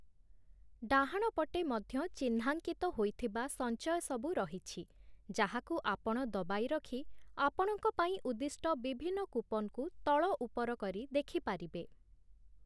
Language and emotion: Odia, neutral